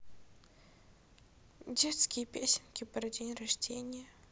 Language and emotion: Russian, sad